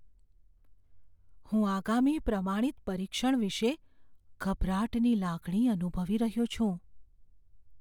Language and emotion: Gujarati, fearful